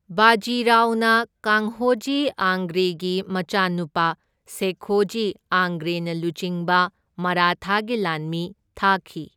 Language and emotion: Manipuri, neutral